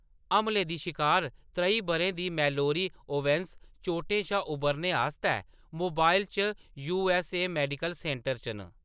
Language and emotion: Dogri, neutral